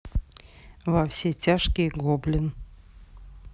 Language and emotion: Russian, neutral